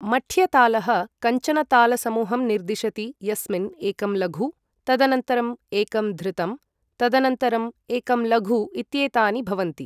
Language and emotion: Sanskrit, neutral